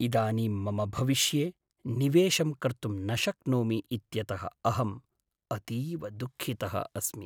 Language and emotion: Sanskrit, sad